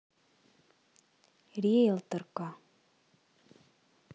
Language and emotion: Russian, neutral